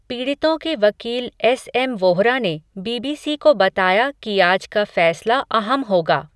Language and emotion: Hindi, neutral